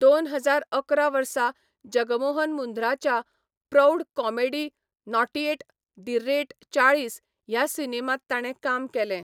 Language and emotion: Goan Konkani, neutral